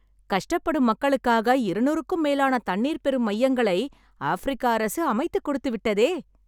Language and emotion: Tamil, happy